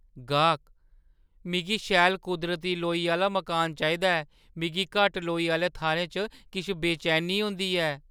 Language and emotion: Dogri, fearful